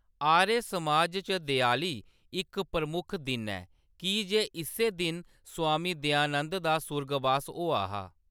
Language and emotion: Dogri, neutral